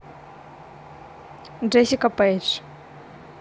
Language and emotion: Russian, neutral